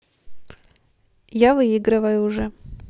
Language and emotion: Russian, neutral